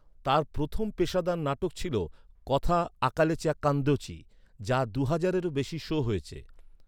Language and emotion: Bengali, neutral